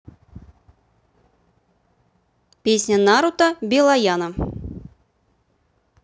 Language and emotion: Russian, neutral